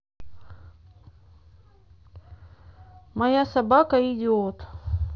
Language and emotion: Russian, neutral